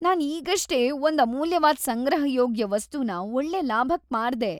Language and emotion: Kannada, happy